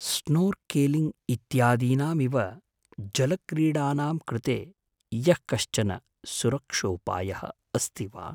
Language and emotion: Sanskrit, fearful